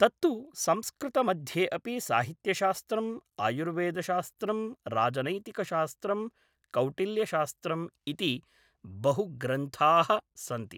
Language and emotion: Sanskrit, neutral